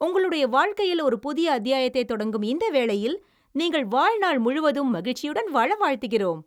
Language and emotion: Tamil, happy